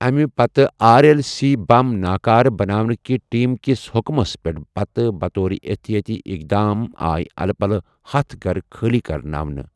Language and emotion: Kashmiri, neutral